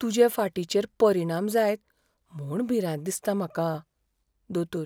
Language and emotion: Goan Konkani, fearful